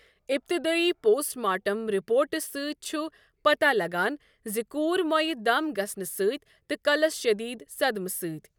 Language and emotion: Kashmiri, neutral